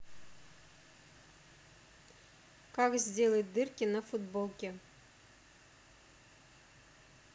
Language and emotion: Russian, neutral